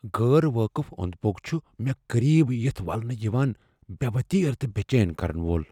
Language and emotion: Kashmiri, fearful